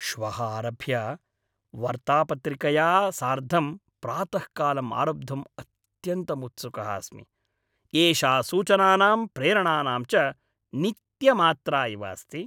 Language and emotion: Sanskrit, happy